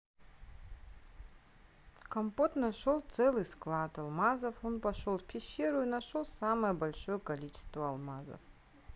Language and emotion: Russian, neutral